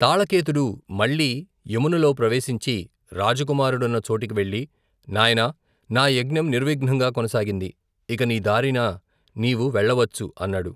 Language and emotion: Telugu, neutral